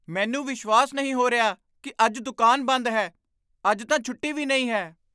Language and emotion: Punjabi, surprised